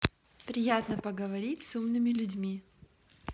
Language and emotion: Russian, positive